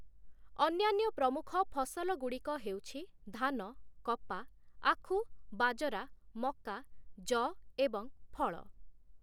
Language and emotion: Odia, neutral